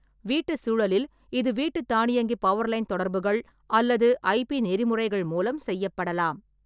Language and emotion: Tamil, neutral